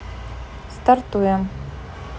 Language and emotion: Russian, neutral